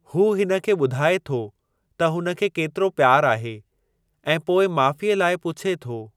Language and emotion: Sindhi, neutral